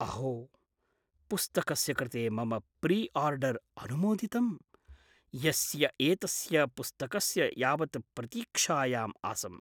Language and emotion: Sanskrit, surprised